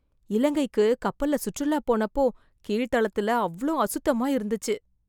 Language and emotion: Tamil, disgusted